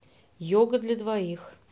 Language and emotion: Russian, neutral